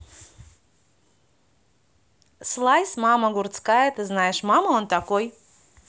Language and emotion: Russian, neutral